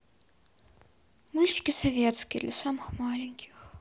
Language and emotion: Russian, sad